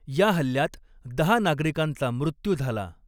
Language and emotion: Marathi, neutral